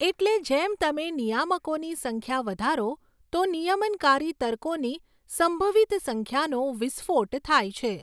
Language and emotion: Gujarati, neutral